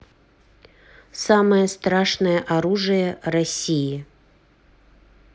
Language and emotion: Russian, neutral